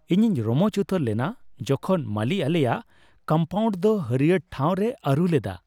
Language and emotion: Santali, happy